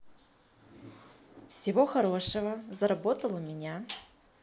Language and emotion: Russian, positive